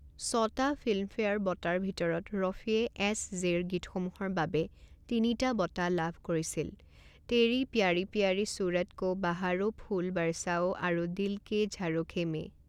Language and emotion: Assamese, neutral